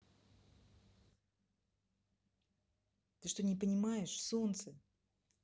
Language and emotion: Russian, angry